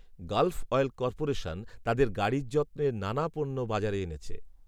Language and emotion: Bengali, neutral